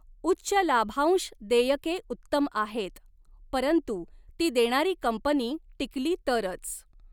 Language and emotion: Marathi, neutral